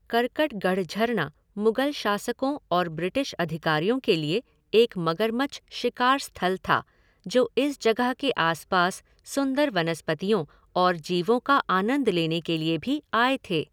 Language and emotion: Hindi, neutral